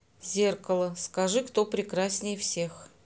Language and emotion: Russian, neutral